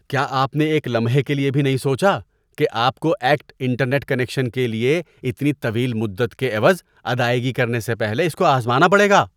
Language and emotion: Urdu, disgusted